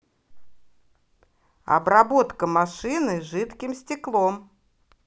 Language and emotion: Russian, positive